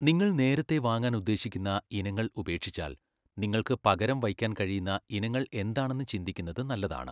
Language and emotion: Malayalam, neutral